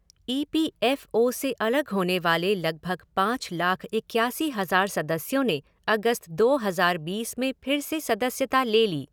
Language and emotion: Hindi, neutral